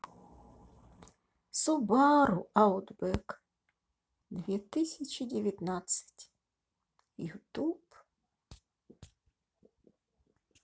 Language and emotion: Russian, sad